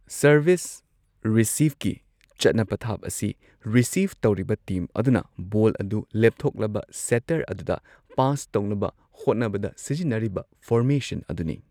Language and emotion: Manipuri, neutral